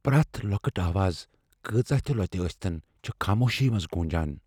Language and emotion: Kashmiri, fearful